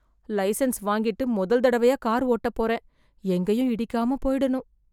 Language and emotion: Tamil, fearful